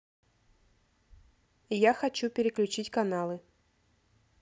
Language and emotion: Russian, neutral